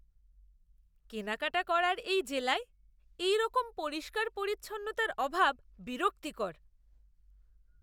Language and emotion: Bengali, disgusted